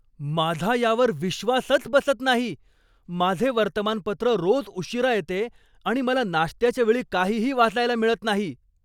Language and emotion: Marathi, angry